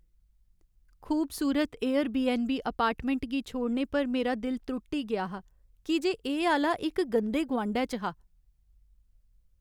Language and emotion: Dogri, sad